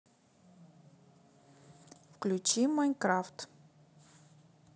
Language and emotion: Russian, neutral